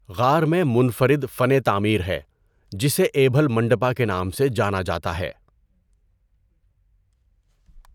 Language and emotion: Urdu, neutral